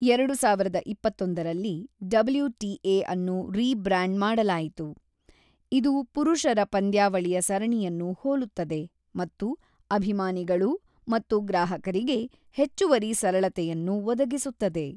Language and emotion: Kannada, neutral